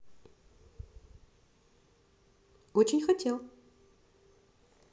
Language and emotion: Russian, positive